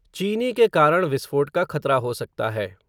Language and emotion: Hindi, neutral